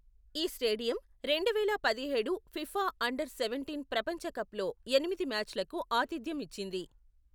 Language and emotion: Telugu, neutral